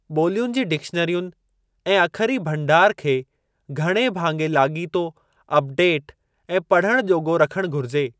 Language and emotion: Sindhi, neutral